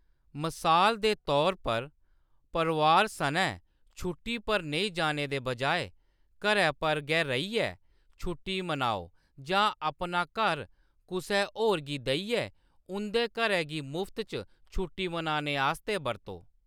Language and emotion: Dogri, neutral